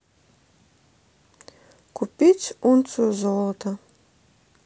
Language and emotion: Russian, neutral